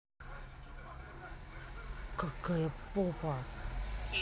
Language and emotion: Russian, angry